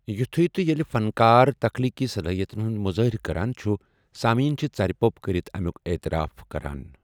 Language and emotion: Kashmiri, neutral